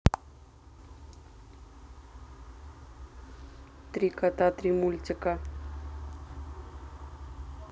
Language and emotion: Russian, neutral